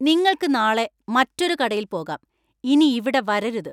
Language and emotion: Malayalam, angry